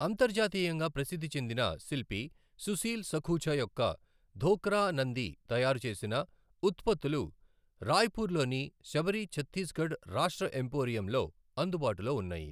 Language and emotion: Telugu, neutral